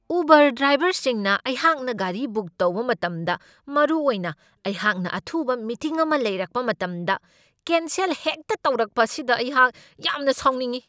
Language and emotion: Manipuri, angry